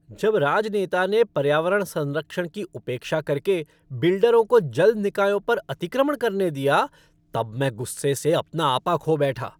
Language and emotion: Hindi, angry